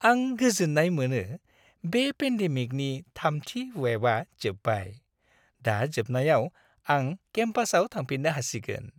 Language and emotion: Bodo, happy